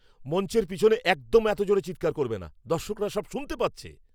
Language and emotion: Bengali, angry